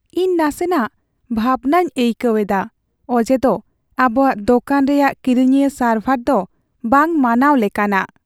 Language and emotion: Santali, sad